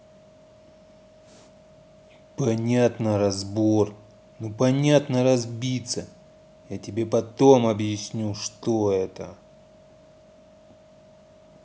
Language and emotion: Russian, angry